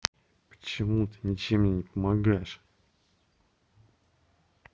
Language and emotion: Russian, angry